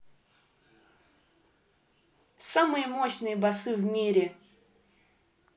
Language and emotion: Russian, positive